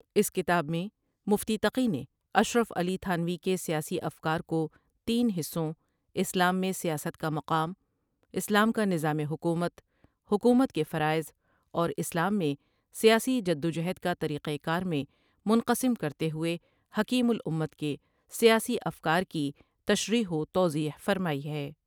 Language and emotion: Urdu, neutral